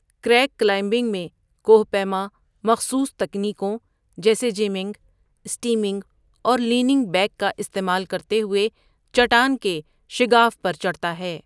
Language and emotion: Urdu, neutral